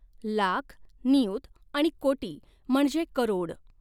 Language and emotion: Marathi, neutral